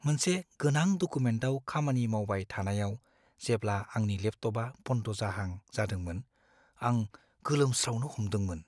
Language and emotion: Bodo, fearful